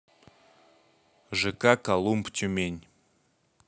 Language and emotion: Russian, neutral